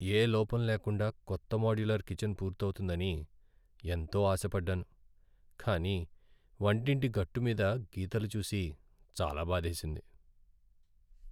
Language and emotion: Telugu, sad